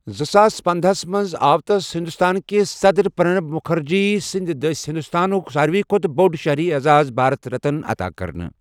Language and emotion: Kashmiri, neutral